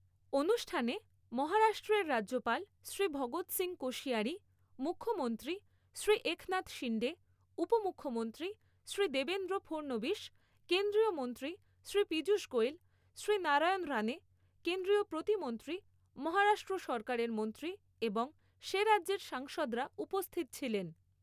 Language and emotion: Bengali, neutral